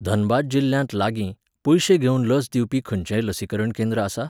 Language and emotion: Goan Konkani, neutral